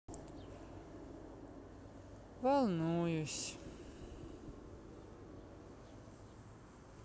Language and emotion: Russian, sad